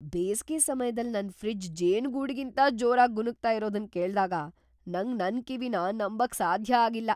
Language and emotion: Kannada, surprised